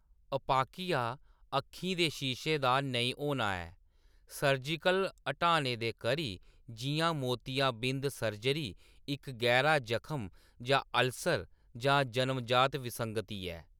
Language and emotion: Dogri, neutral